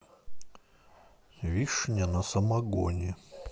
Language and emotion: Russian, neutral